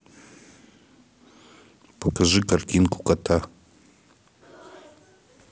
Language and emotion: Russian, neutral